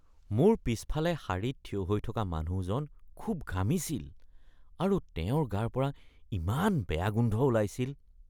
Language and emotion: Assamese, disgusted